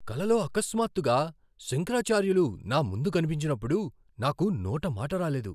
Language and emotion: Telugu, surprised